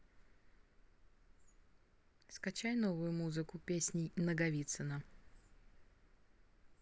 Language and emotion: Russian, neutral